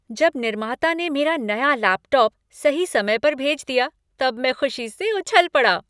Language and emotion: Hindi, happy